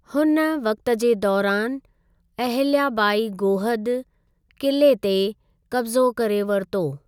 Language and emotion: Sindhi, neutral